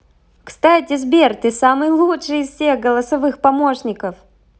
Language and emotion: Russian, positive